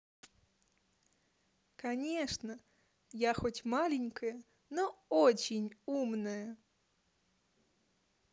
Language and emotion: Russian, positive